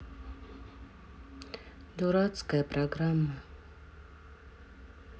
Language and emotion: Russian, sad